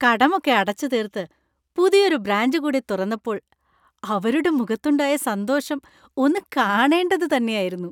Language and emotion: Malayalam, happy